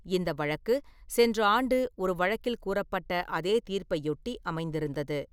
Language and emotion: Tamil, neutral